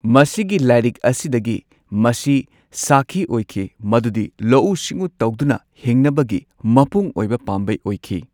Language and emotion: Manipuri, neutral